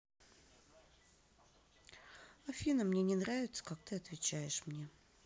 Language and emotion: Russian, neutral